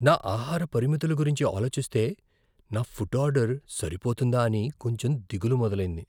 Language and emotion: Telugu, fearful